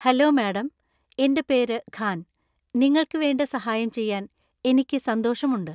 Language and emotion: Malayalam, happy